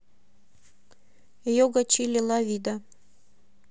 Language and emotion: Russian, neutral